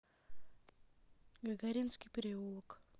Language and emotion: Russian, neutral